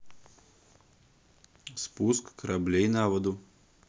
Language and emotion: Russian, neutral